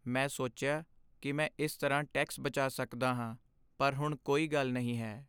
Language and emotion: Punjabi, sad